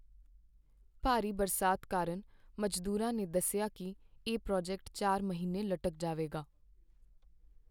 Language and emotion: Punjabi, sad